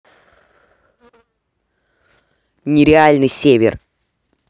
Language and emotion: Russian, neutral